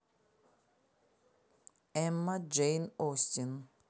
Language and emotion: Russian, neutral